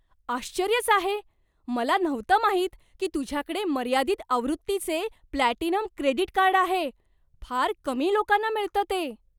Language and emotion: Marathi, surprised